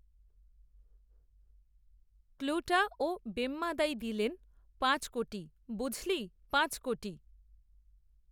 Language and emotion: Bengali, neutral